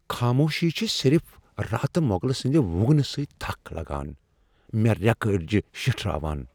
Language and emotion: Kashmiri, fearful